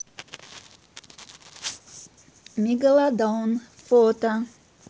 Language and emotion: Russian, neutral